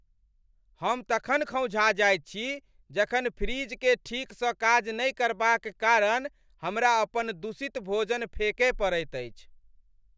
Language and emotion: Maithili, angry